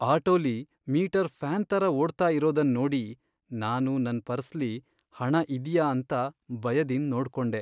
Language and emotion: Kannada, sad